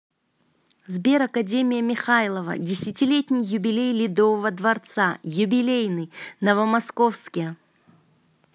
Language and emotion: Russian, positive